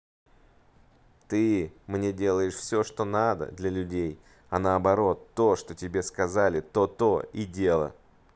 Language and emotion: Russian, neutral